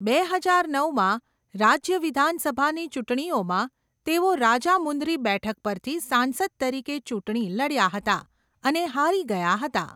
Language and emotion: Gujarati, neutral